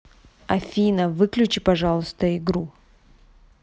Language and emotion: Russian, neutral